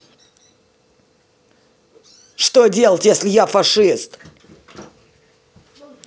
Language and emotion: Russian, angry